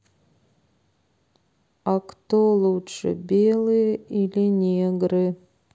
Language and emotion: Russian, sad